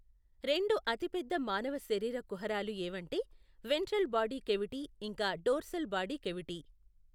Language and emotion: Telugu, neutral